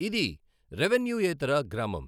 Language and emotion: Telugu, neutral